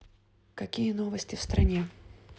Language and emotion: Russian, neutral